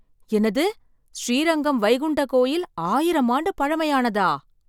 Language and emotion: Tamil, surprised